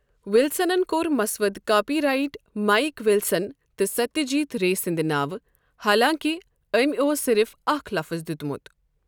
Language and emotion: Kashmiri, neutral